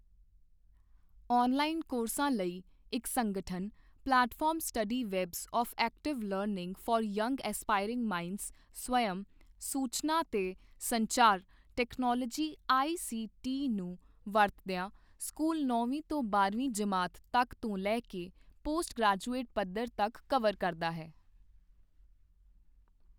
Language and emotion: Punjabi, neutral